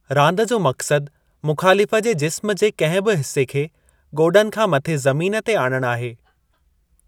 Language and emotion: Sindhi, neutral